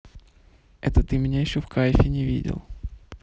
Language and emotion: Russian, neutral